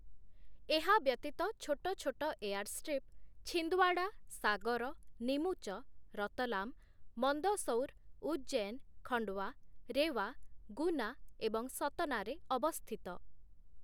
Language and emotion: Odia, neutral